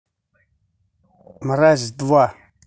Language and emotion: Russian, angry